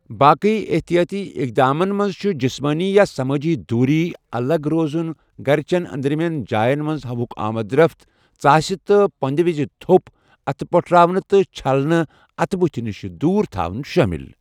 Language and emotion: Kashmiri, neutral